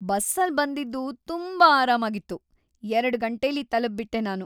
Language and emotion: Kannada, happy